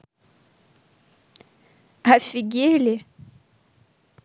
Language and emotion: Russian, positive